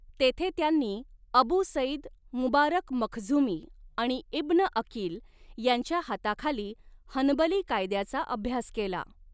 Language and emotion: Marathi, neutral